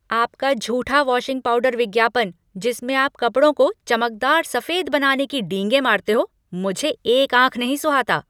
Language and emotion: Hindi, angry